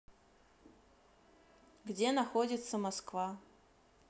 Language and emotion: Russian, neutral